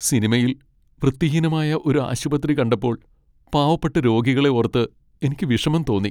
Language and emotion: Malayalam, sad